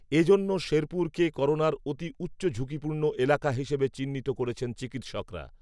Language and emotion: Bengali, neutral